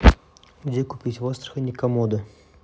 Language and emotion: Russian, neutral